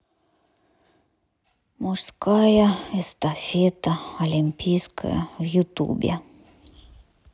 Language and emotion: Russian, sad